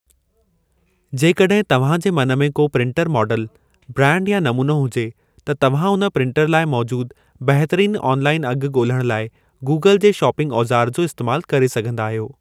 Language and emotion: Sindhi, neutral